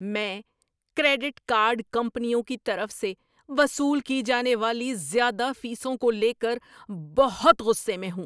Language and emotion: Urdu, angry